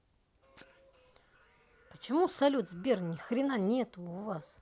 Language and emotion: Russian, angry